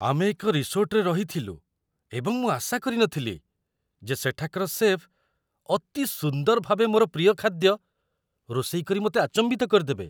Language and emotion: Odia, surprised